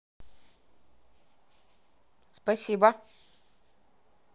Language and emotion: Russian, neutral